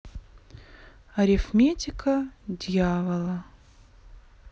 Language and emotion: Russian, neutral